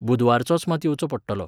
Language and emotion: Goan Konkani, neutral